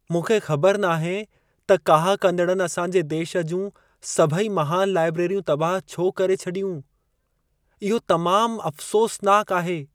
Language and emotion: Sindhi, sad